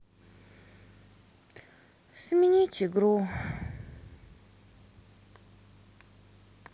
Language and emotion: Russian, sad